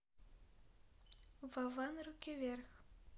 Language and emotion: Russian, neutral